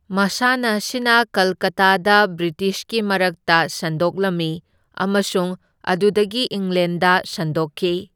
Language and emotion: Manipuri, neutral